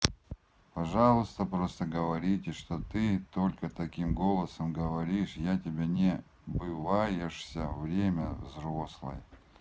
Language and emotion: Russian, neutral